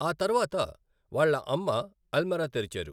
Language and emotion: Telugu, neutral